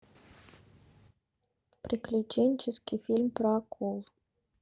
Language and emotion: Russian, neutral